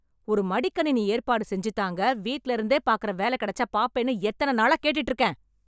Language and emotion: Tamil, angry